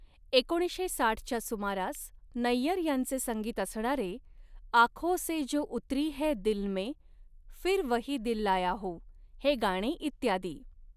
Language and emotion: Marathi, neutral